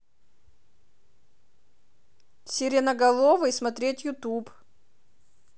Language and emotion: Russian, neutral